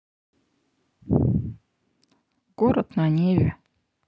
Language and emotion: Russian, sad